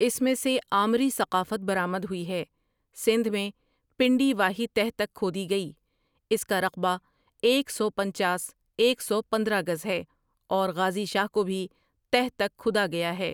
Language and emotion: Urdu, neutral